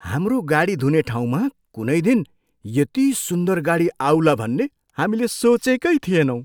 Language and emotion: Nepali, surprised